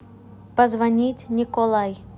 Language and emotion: Russian, neutral